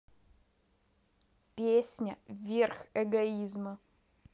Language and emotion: Russian, neutral